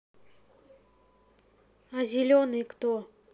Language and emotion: Russian, neutral